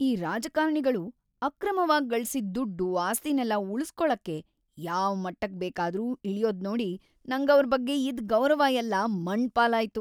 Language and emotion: Kannada, disgusted